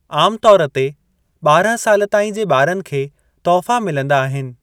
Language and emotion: Sindhi, neutral